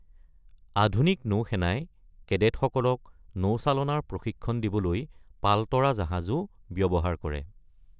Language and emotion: Assamese, neutral